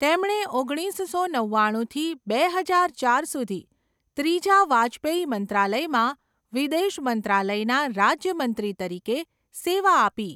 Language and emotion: Gujarati, neutral